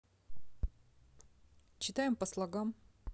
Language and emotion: Russian, neutral